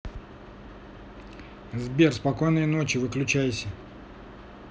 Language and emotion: Russian, neutral